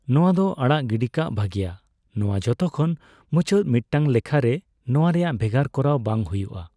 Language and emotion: Santali, neutral